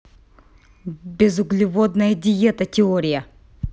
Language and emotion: Russian, angry